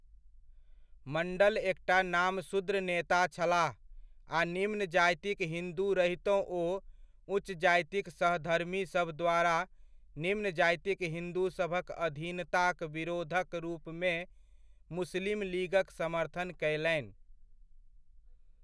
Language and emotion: Maithili, neutral